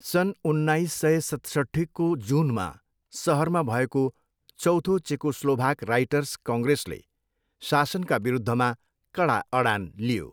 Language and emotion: Nepali, neutral